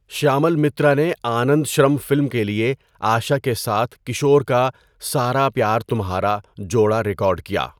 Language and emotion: Urdu, neutral